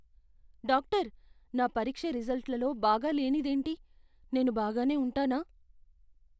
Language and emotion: Telugu, fearful